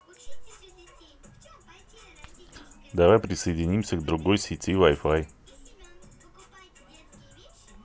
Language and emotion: Russian, neutral